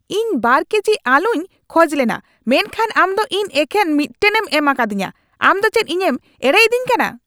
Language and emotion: Santali, angry